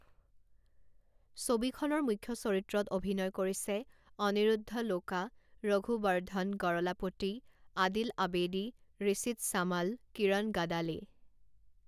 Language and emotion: Assamese, neutral